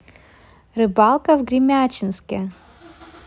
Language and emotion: Russian, positive